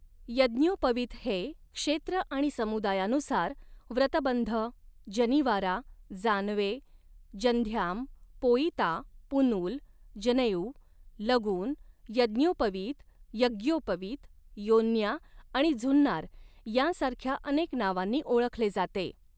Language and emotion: Marathi, neutral